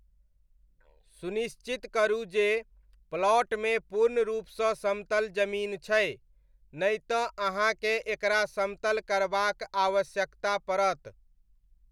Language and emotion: Maithili, neutral